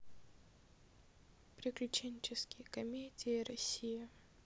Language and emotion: Russian, neutral